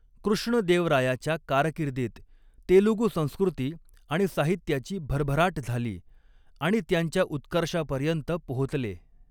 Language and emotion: Marathi, neutral